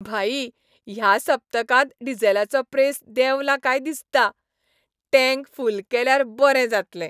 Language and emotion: Goan Konkani, happy